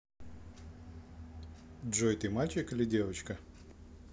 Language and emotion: Russian, neutral